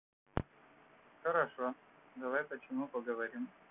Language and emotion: Russian, neutral